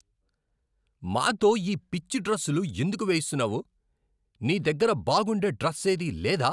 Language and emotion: Telugu, angry